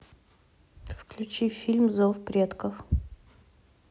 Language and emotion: Russian, neutral